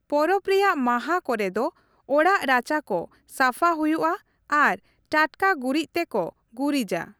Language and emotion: Santali, neutral